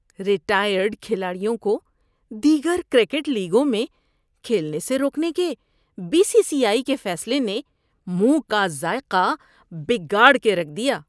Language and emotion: Urdu, disgusted